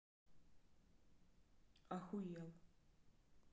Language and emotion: Russian, neutral